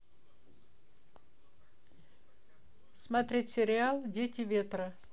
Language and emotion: Russian, neutral